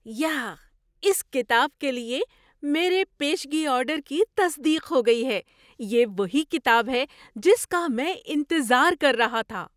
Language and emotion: Urdu, surprised